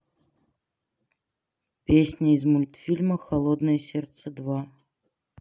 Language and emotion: Russian, neutral